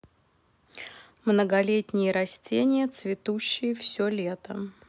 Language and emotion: Russian, neutral